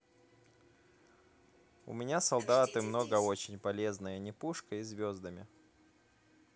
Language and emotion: Russian, neutral